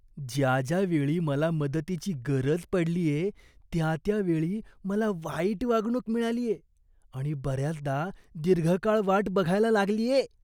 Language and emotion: Marathi, disgusted